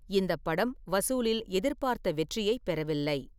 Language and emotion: Tamil, neutral